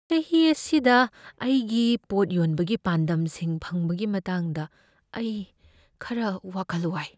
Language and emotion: Manipuri, fearful